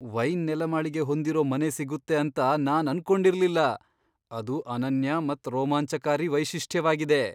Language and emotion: Kannada, surprised